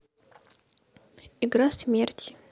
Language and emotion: Russian, neutral